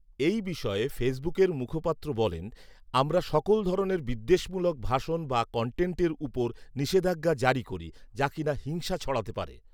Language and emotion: Bengali, neutral